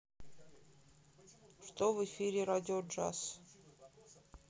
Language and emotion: Russian, neutral